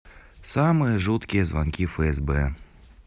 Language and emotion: Russian, neutral